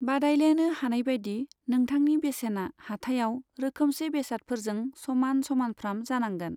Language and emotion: Bodo, neutral